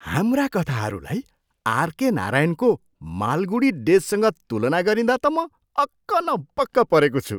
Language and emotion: Nepali, surprised